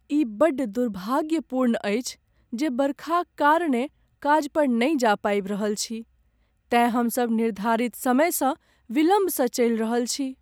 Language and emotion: Maithili, sad